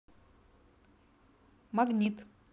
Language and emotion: Russian, neutral